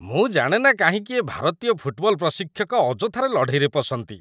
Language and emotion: Odia, disgusted